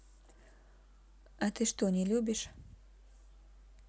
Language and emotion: Russian, neutral